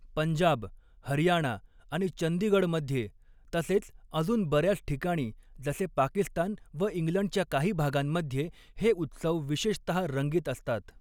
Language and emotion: Marathi, neutral